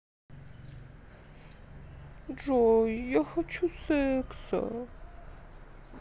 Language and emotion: Russian, sad